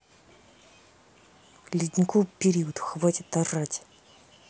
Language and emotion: Russian, angry